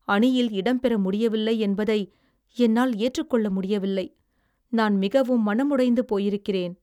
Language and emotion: Tamil, sad